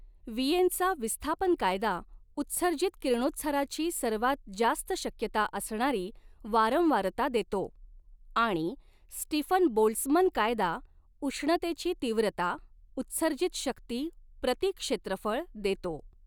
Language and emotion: Marathi, neutral